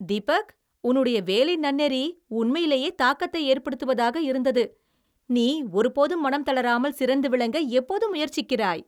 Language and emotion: Tamil, happy